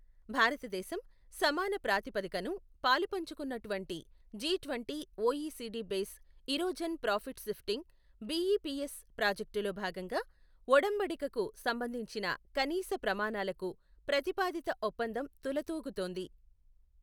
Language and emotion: Telugu, neutral